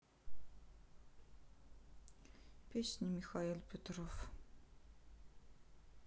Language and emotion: Russian, sad